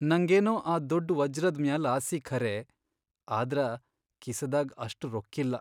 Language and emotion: Kannada, sad